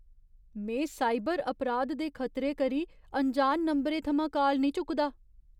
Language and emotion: Dogri, fearful